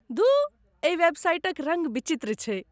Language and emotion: Maithili, disgusted